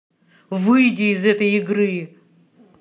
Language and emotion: Russian, angry